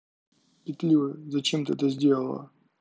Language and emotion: Russian, neutral